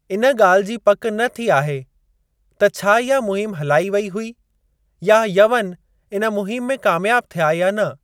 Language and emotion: Sindhi, neutral